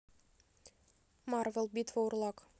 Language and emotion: Russian, neutral